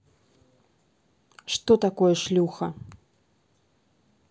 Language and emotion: Russian, neutral